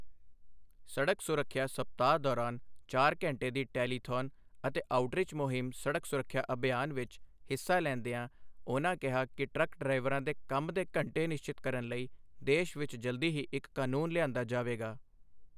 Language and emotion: Punjabi, neutral